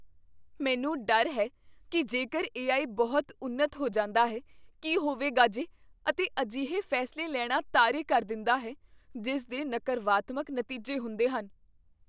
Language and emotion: Punjabi, fearful